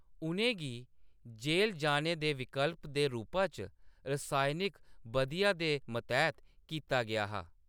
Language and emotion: Dogri, neutral